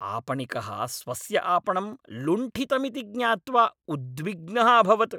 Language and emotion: Sanskrit, angry